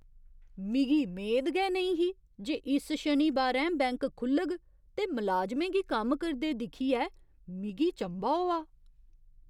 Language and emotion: Dogri, surprised